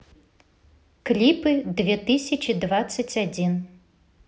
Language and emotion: Russian, neutral